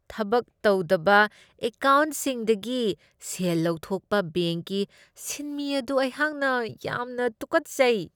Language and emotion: Manipuri, disgusted